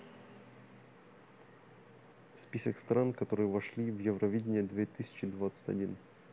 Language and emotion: Russian, neutral